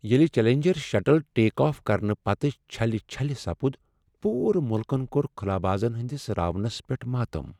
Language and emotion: Kashmiri, sad